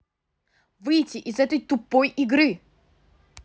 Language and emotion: Russian, angry